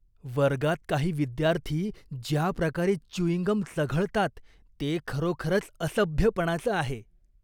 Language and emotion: Marathi, disgusted